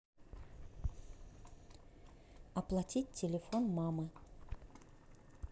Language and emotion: Russian, neutral